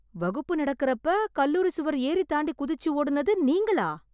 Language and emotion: Tamil, surprised